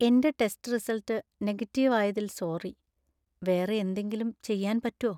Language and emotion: Malayalam, sad